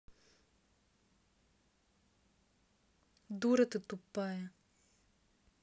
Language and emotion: Russian, angry